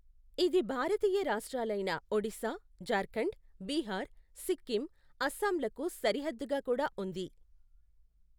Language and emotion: Telugu, neutral